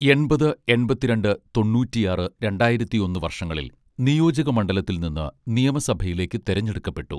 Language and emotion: Malayalam, neutral